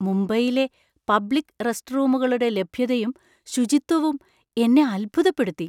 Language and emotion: Malayalam, surprised